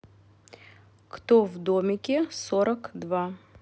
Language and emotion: Russian, neutral